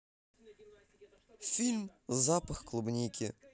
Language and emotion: Russian, positive